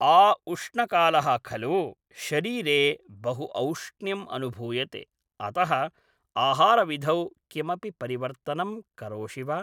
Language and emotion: Sanskrit, neutral